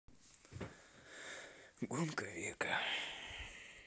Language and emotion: Russian, sad